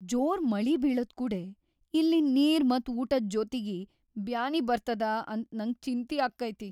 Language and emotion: Kannada, fearful